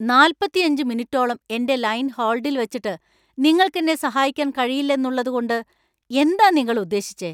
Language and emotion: Malayalam, angry